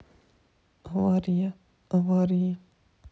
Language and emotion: Russian, sad